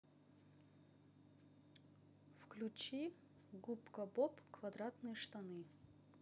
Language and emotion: Russian, neutral